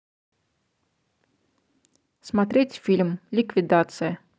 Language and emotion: Russian, positive